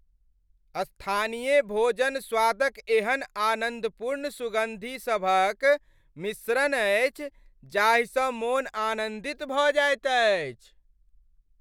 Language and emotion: Maithili, happy